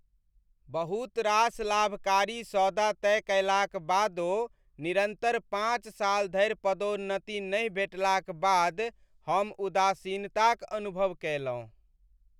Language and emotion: Maithili, sad